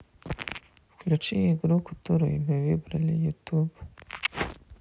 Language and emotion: Russian, neutral